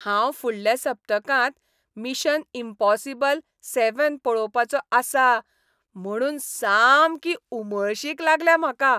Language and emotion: Goan Konkani, happy